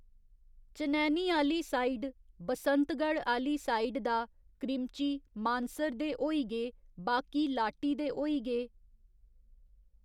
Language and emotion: Dogri, neutral